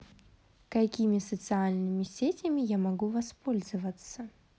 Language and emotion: Russian, positive